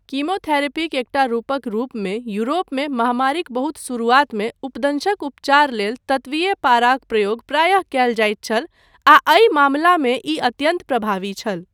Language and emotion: Maithili, neutral